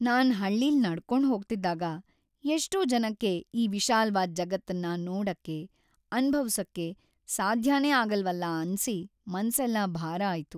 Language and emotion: Kannada, sad